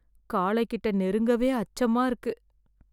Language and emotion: Tamil, fearful